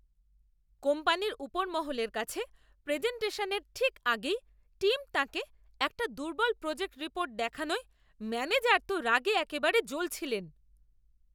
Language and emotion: Bengali, angry